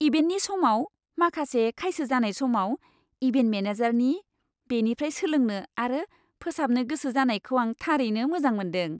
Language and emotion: Bodo, happy